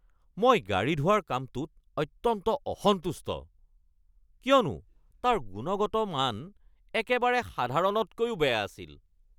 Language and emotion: Assamese, angry